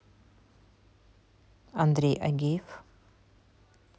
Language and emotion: Russian, neutral